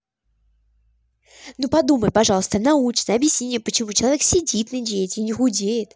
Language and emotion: Russian, angry